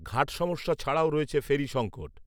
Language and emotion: Bengali, neutral